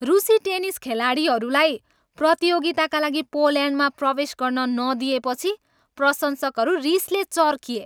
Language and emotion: Nepali, angry